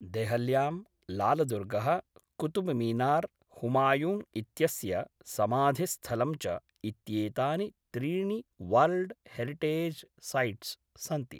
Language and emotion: Sanskrit, neutral